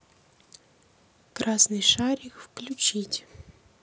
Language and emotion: Russian, neutral